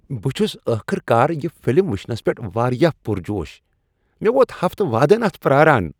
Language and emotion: Kashmiri, happy